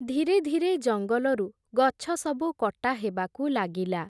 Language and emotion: Odia, neutral